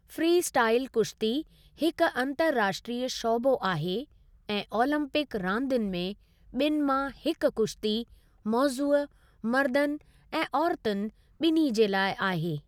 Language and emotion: Sindhi, neutral